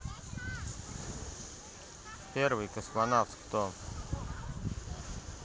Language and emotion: Russian, neutral